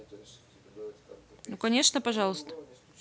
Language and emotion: Russian, neutral